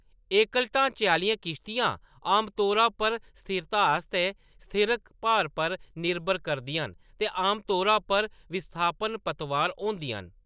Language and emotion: Dogri, neutral